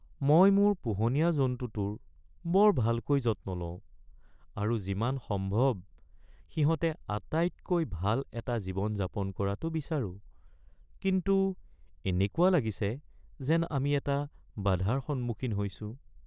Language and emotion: Assamese, sad